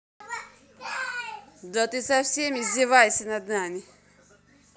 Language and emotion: Russian, angry